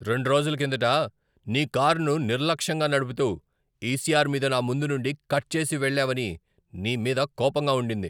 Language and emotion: Telugu, angry